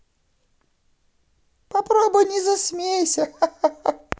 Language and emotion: Russian, positive